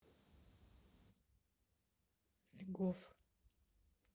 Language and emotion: Russian, neutral